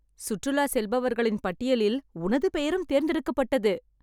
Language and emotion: Tamil, happy